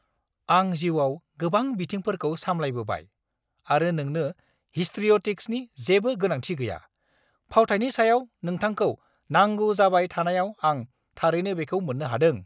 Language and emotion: Bodo, angry